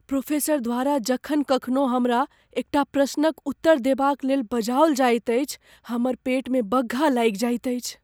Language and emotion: Maithili, fearful